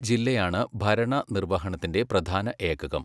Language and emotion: Malayalam, neutral